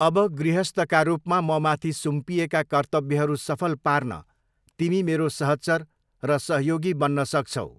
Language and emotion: Nepali, neutral